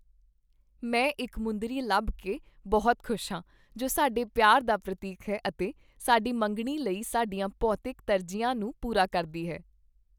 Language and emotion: Punjabi, happy